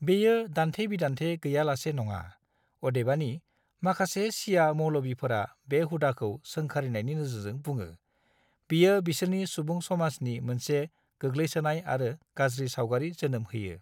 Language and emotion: Bodo, neutral